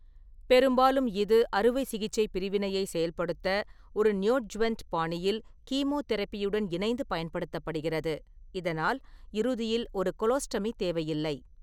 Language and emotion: Tamil, neutral